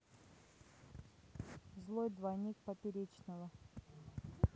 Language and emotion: Russian, neutral